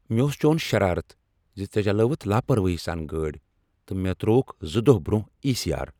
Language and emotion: Kashmiri, angry